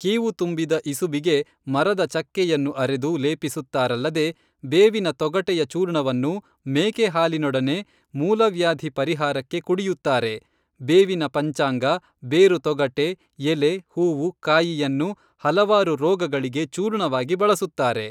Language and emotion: Kannada, neutral